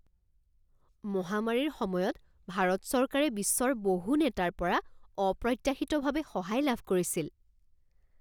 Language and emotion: Assamese, surprised